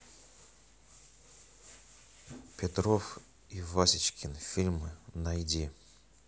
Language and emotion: Russian, neutral